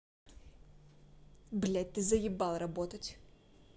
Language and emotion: Russian, angry